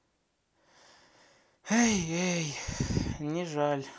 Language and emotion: Russian, sad